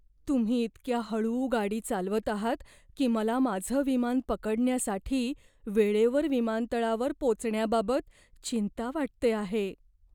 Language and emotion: Marathi, fearful